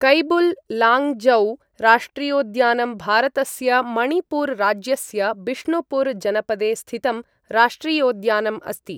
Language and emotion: Sanskrit, neutral